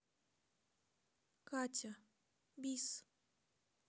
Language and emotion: Russian, sad